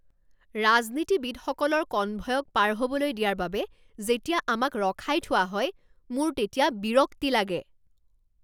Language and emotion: Assamese, angry